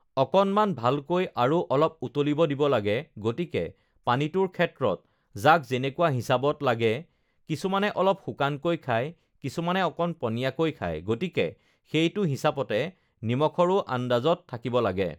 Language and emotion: Assamese, neutral